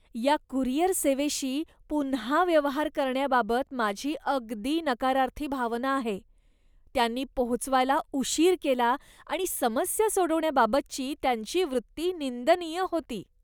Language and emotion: Marathi, disgusted